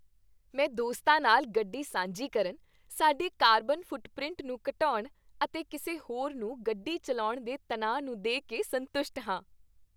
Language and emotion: Punjabi, happy